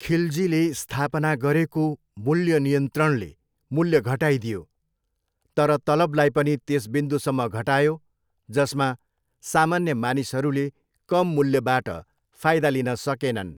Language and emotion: Nepali, neutral